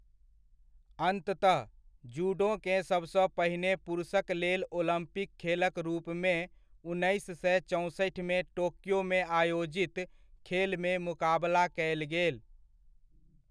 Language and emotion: Maithili, neutral